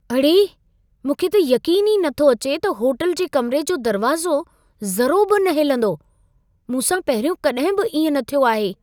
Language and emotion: Sindhi, surprised